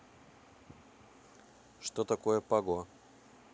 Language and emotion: Russian, neutral